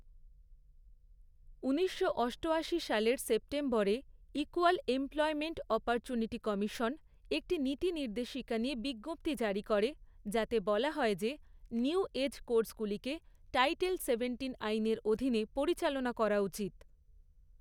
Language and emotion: Bengali, neutral